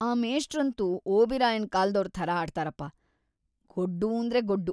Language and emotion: Kannada, disgusted